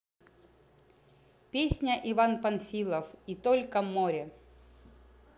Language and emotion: Russian, positive